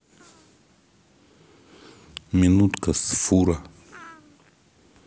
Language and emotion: Russian, neutral